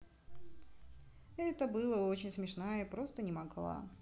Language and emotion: Russian, neutral